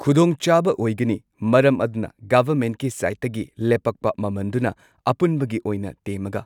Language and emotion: Manipuri, neutral